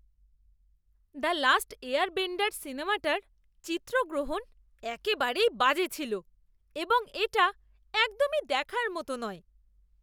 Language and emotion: Bengali, disgusted